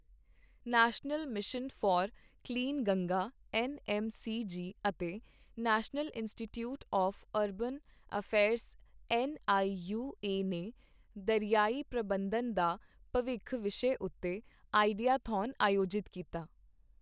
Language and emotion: Punjabi, neutral